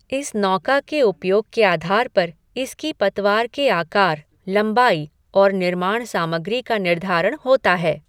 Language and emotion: Hindi, neutral